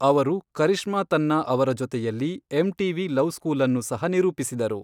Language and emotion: Kannada, neutral